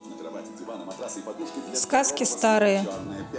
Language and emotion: Russian, neutral